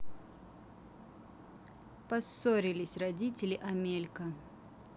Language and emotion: Russian, neutral